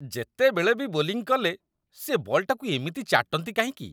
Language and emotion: Odia, disgusted